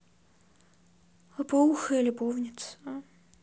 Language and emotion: Russian, neutral